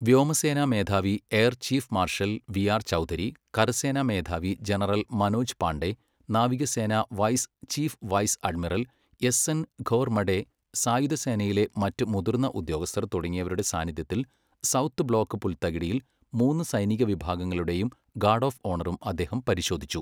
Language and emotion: Malayalam, neutral